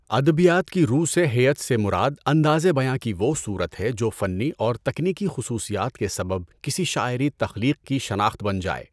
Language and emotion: Urdu, neutral